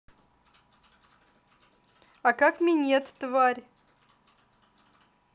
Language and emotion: Russian, angry